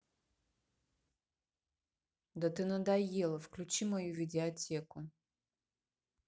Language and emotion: Russian, angry